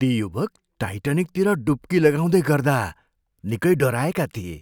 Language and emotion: Nepali, fearful